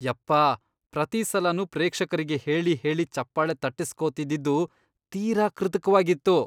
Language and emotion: Kannada, disgusted